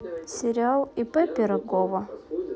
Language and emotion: Russian, neutral